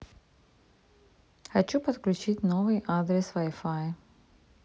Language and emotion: Russian, neutral